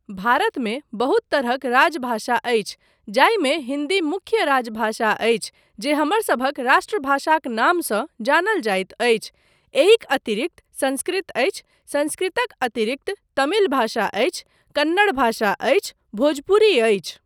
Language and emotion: Maithili, neutral